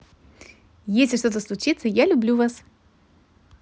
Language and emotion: Russian, positive